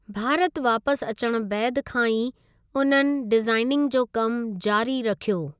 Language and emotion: Sindhi, neutral